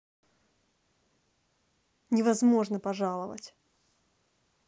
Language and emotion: Russian, angry